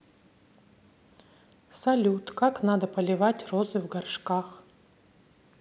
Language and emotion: Russian, neutral